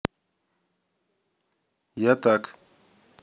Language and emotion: Russian, neutral